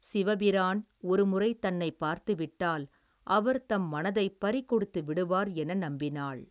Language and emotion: Tamil, neutral